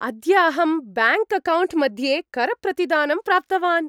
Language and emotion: Sanskrit, happy